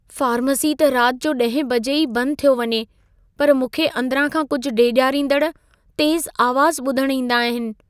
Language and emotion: Sindhi, fearful